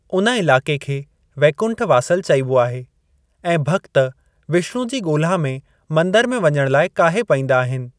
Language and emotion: Sindhi, neutral